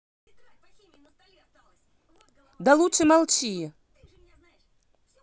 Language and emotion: Russian, angry